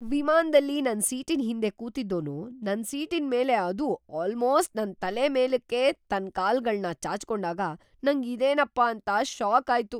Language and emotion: Kannada, surprised